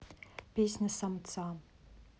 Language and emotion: Russian, neutral